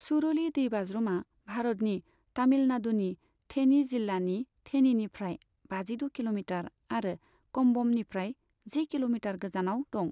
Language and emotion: Bodo, neutral